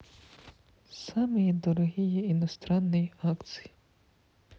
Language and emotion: Russian, sad